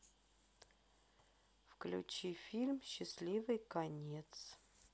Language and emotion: Russian, neutral